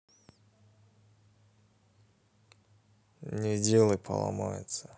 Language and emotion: Russian, sad